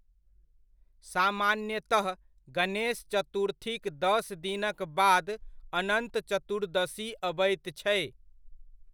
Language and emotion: Maithili, neutral